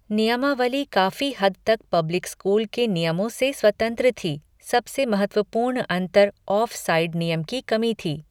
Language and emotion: Hindi, neutral